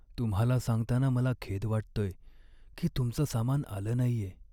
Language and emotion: Marathi, sad